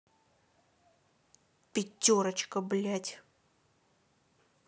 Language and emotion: Russian, angry